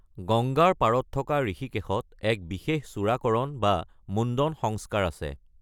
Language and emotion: Assamese, neutral